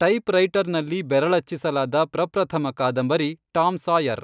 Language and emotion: Kannada, neutral